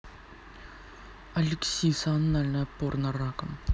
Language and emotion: Russian, neutral